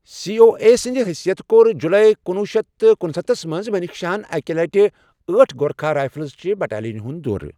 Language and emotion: Kashmiri, neutral